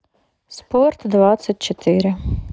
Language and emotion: Russian, neutral